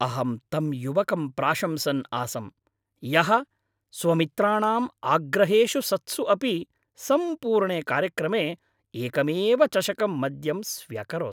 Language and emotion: Sanskrit, happy